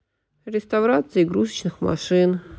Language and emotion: Russian, sad